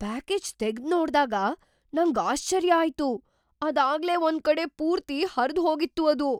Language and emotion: Kannada, surprised